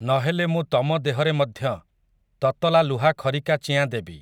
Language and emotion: Odia, neutral